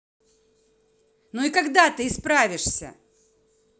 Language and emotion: Russian, angry